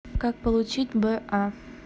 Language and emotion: Russian, neutral